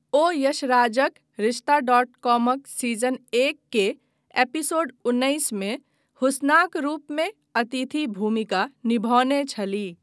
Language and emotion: Maithili, neutral